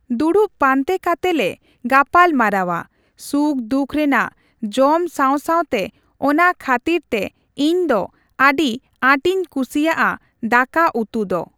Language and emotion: Santali, neutral